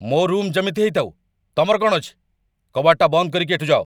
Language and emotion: Odia, angry